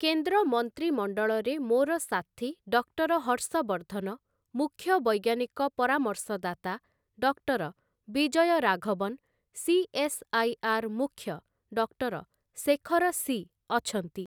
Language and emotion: Odia, neutral